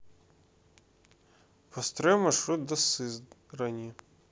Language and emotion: Russian, neutral